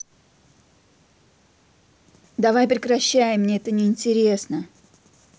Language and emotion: Russian, angry